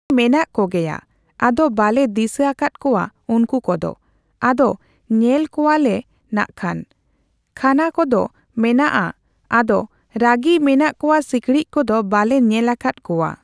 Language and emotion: Santali, neutral